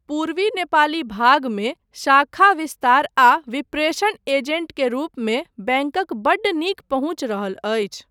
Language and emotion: Maithili, neutral